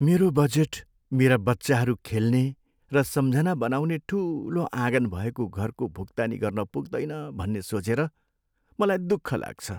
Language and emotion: Nepali, sad